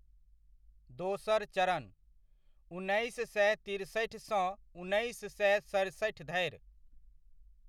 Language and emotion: Maithili, neutral